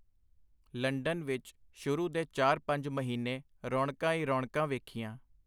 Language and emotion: Punjabi, neutral